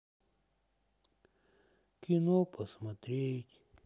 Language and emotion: Russian, sad